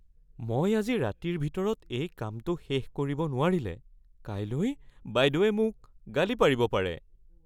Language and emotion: Assamese, fearful